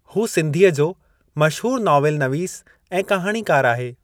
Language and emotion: Sindhi, neutral